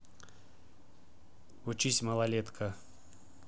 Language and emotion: Russian, neutral